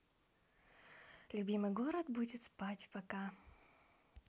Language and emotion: Russian, neutral